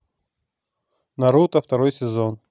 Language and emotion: Russian, neutral